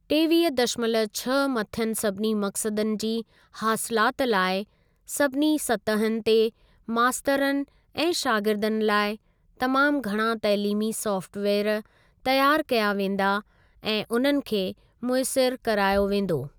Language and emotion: Sindhi, neutral